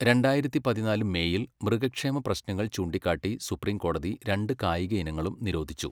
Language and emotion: Malayalam, neutral